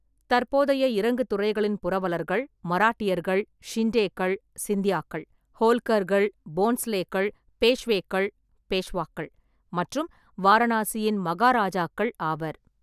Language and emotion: Tamil, neutral